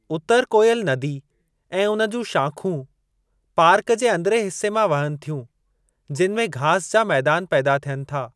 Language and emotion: Sindhi, neutral